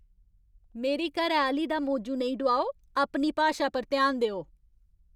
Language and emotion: Dogri, angry